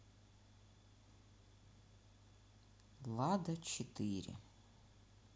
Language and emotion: Russian, neutral